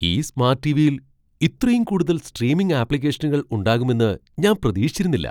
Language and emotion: Malayalam, surprised